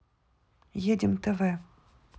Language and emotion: Russian, neutral